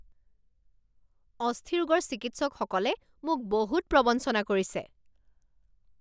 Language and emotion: Assamese, angry